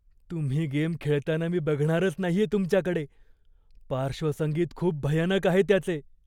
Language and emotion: Marathi, fearful